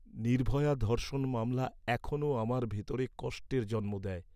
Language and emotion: Bengali, sad